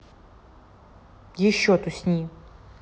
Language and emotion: Russian, neutral